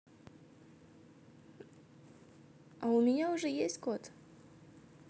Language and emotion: Russian, positive